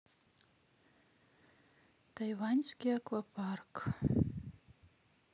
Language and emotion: Russian, sad